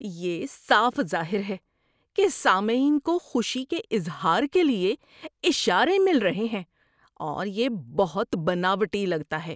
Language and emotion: Urdu, disgusted